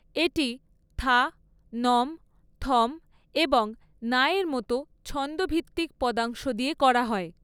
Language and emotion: Bengali, neutral